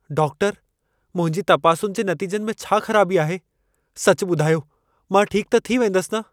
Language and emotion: Sindhi, fearful